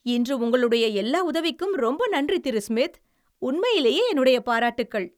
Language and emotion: Tamil, happy